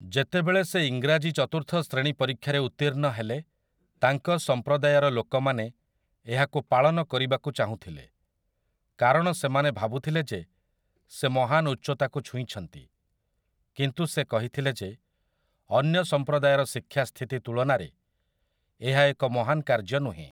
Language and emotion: Odia, neutral